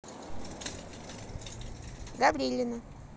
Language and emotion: Russian, neutral